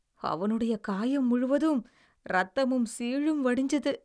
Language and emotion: Tamil, disgusted